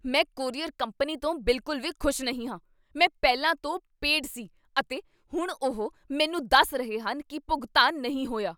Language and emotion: Punjabi, angry